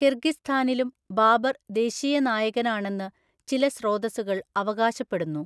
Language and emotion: Malayalam, neutral